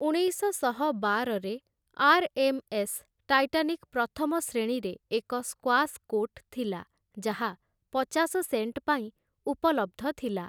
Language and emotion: Odia, neutral